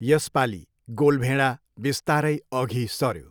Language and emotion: Nepali, neutral